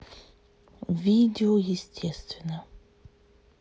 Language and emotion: Russian, neutral